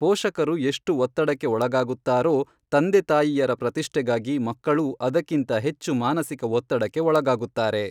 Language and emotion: Kannada, neutral